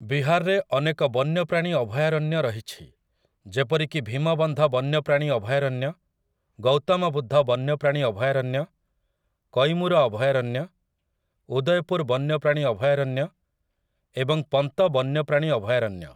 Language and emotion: Odia, neutral